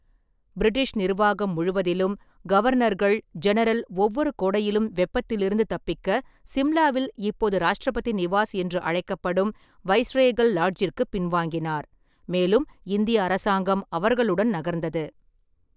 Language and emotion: Tamil, neutral